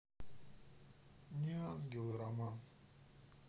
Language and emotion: Russian, neutral